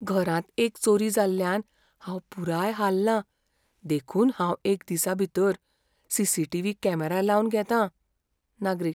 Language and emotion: Goan Konkani, fearful